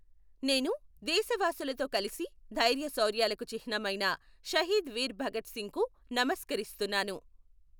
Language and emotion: Telugu, neutral